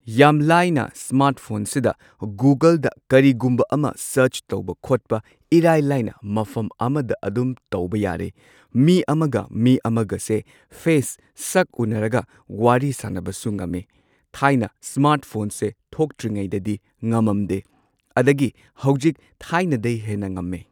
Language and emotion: Manipuri, neutral